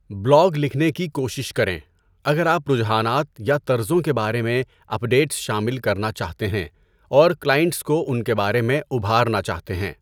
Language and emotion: Urdu, neutral